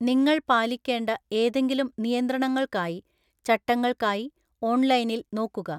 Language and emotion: Malayalam, neutral